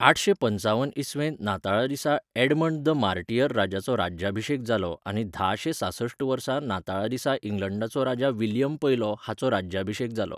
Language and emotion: Goan Konkani, neutral